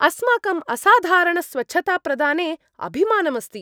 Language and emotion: Sanskrit, happy